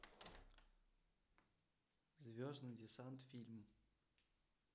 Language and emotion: Russian, neutral